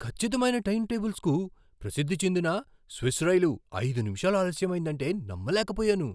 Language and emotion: Telugu, surprised